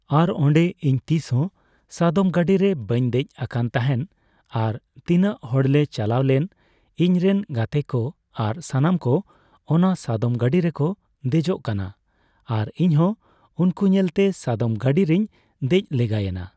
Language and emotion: Santali, neutral